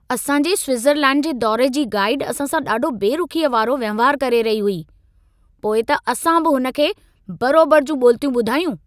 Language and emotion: Sindhi, angry